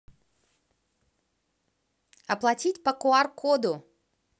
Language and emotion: Russian, positive